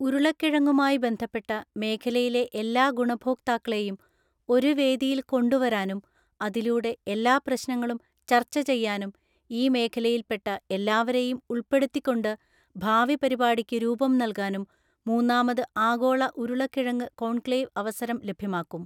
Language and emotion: Malayalam, neutral